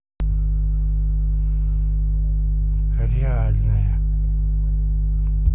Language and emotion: Russian, neutral